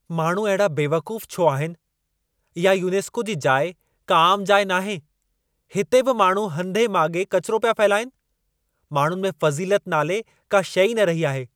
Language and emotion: Sindhi, angry